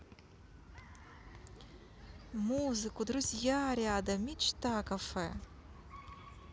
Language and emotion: Russian, positive